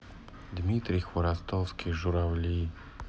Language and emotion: Russian, sad